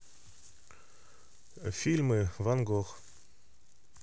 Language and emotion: Russian, neutral